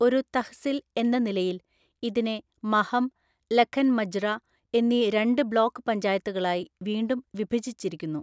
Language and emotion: Malayalam, neutral